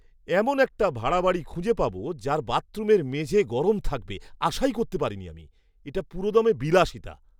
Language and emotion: Bengali, surprised